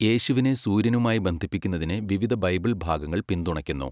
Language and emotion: Malayalam, neutral